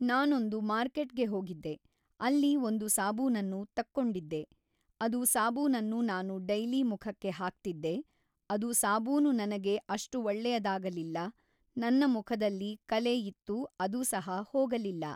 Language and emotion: Kannada, neutral